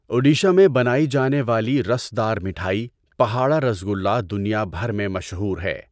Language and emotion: Urdu, neutral